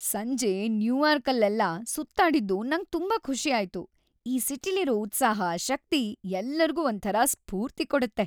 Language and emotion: Kannada, happy